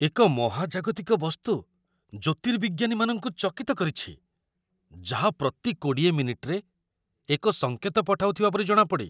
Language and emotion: Odia, surprised